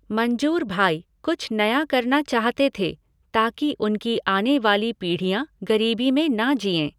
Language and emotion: Hindi, neutral